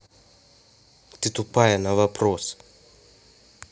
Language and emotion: Russian, angry